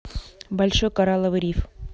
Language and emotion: Russian, neutral